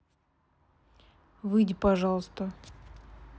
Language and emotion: Russian, neutral